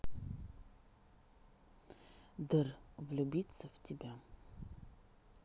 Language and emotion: Russian, neutral